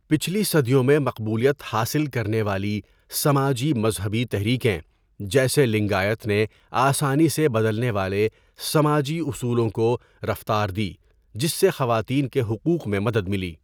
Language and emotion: Urdu, neutral